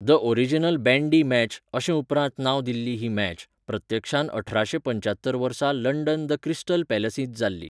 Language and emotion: Goan Konkani, neutral